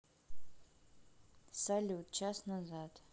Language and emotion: Russian, neutral